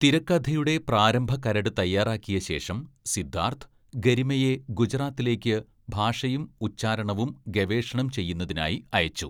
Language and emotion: Malayalam, neutral